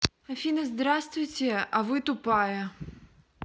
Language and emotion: Russian, neutral